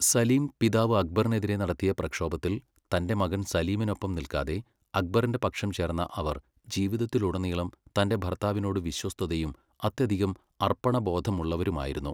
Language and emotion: Malayalam, neutral